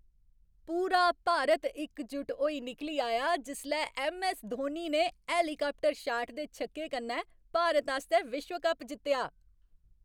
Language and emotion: Dogri, happy